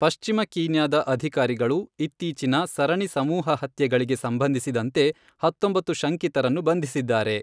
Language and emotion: Kannada, neutral